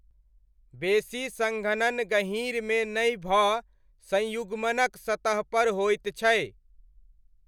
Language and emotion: Maithili, neutral